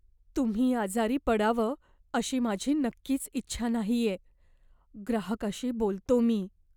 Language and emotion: Marathi, fearful